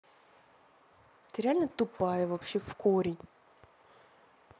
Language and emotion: Russian, angry